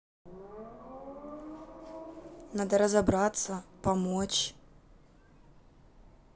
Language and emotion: Russian, neutral